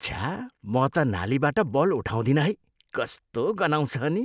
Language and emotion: Nepali, disgusted